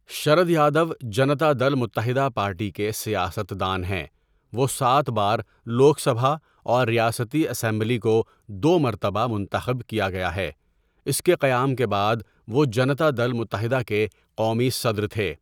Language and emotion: Urdu, neutral